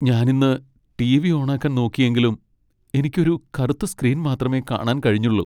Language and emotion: Malayalam, sad